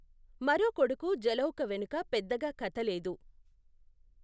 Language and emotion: Telugu, neutral